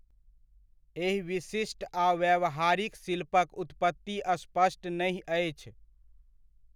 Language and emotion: Maithili, neutral